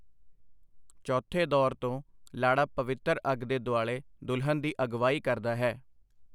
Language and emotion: Punjabi, neutral